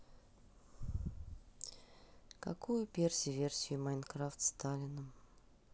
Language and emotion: Russian, sad